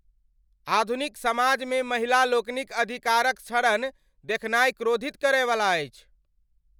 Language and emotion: Maithili, angry